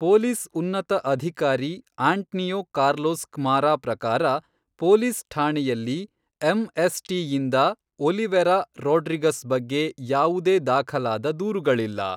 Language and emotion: Kannada, neutral